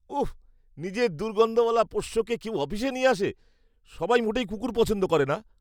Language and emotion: Bengali, disgusted